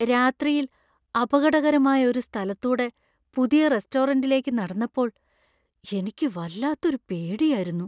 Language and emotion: Malayalam, fearful